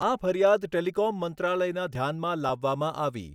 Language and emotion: Gujarati, neutral